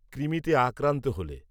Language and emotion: Bengali, neutral